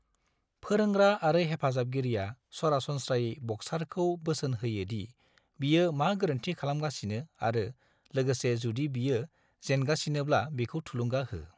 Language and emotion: Bodo, neutral